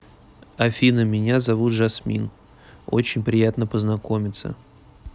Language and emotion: Russian, neutral